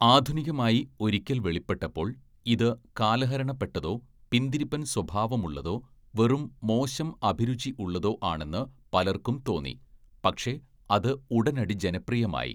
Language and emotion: Malayalam, neutral